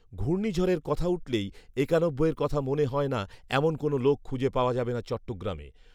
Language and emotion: Bengali, neutral